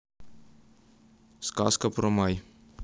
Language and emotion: Russian, neutral